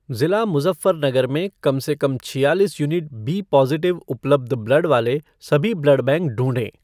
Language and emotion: Hindi, neutral